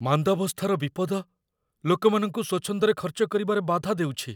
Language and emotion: Odia, fearful